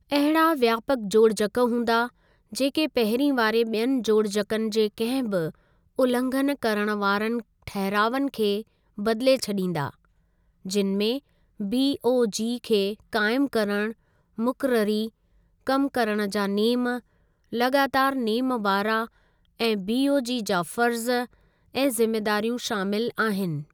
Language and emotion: Sindhi, neutral